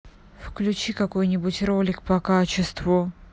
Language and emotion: Russian, angry